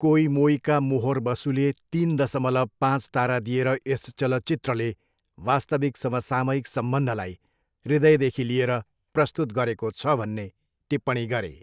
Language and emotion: Nepali, neutral